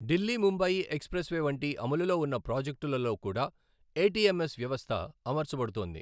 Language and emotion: Telugu, neutral